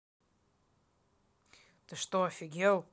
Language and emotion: Russian, angry